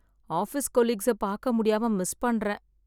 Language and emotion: Tamil, sad